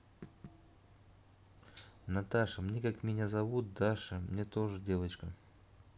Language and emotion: Russian, neutral